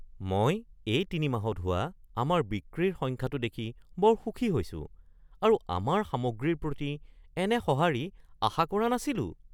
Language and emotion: Assamese, surprised